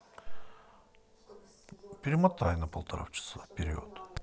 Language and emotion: Russian, neutral